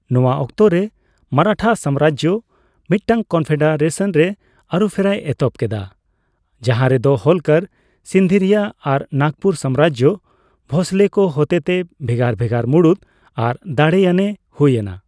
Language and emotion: Santali, neutral